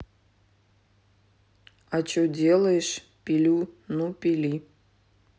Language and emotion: Russian, neutral